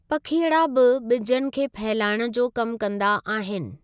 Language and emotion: Sindhi, neutral